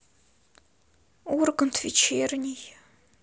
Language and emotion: Russian, sad